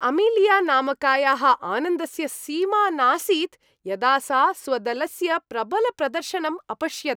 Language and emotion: Sanskrit, happy